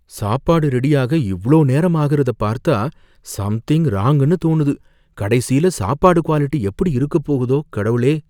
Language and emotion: Tamil, fearful